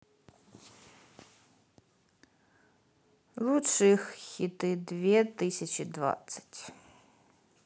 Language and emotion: Russian, sad